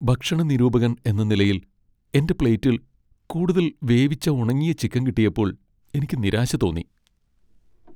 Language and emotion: Malayalam, sad